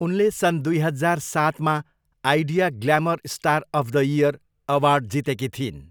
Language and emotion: Nepali, neutral